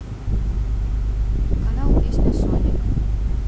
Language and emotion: Russian, neutral